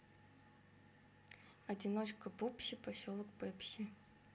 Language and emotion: Russian, neutral